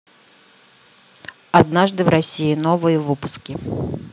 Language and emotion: Russian, neutral